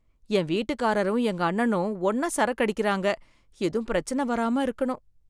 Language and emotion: Tamil, fearful